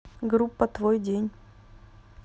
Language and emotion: Russian, neutral